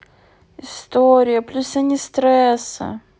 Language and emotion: Russian, sad